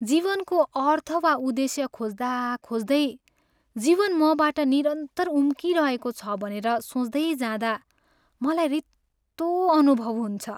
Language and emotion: Nepali, sad